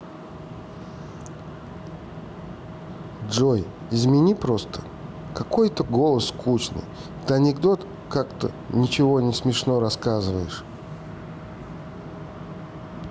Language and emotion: Russian, neutral